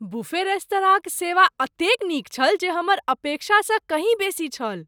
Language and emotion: Maithili, surprised